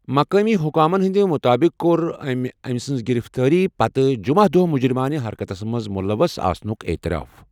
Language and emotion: Kashmiri, neutral